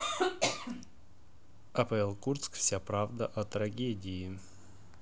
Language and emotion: Russian, neutral